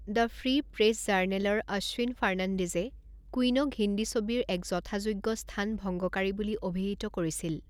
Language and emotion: Assamese, neutral